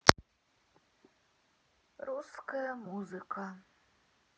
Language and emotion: Russian, sad